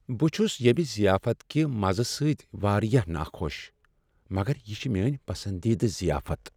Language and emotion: Kashmiri, sad